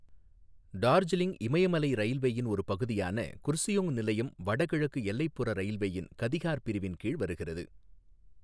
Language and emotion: Tamil, neutral